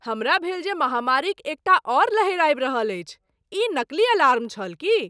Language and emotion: Maithili, surprised